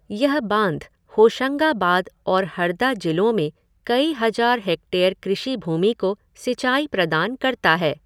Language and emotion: Hindi, neutral